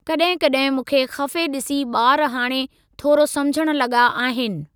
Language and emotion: Sindhi, neutral